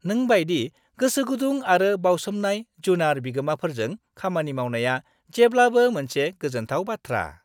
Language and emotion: Bodo, happy